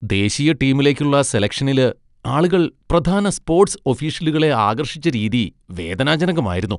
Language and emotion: Malayalam, disgusted